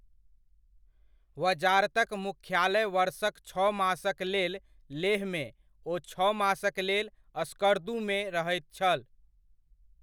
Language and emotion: Maithili, neutral